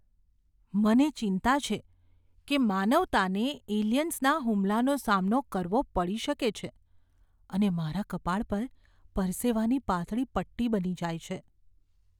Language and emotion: Gujarati, fearful